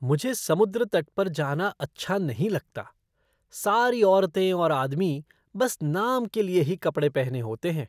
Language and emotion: Hindi, disgusted